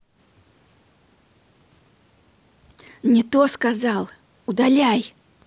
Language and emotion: Russian, neutral